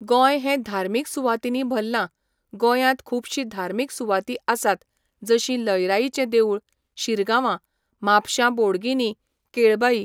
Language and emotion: Goan Konkani, neutral